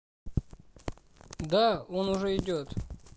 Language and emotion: Russian, neutral